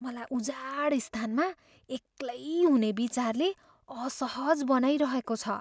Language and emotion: Nepali, fearful